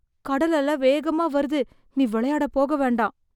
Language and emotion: Tamil, fearful